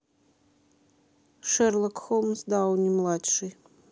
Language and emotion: Russian, neutral